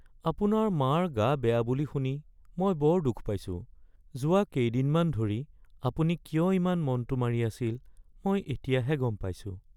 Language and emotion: Assamese, sad